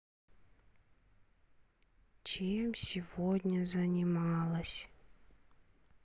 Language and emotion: Russian, sad